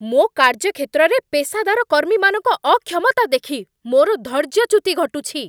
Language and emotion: Odia, angry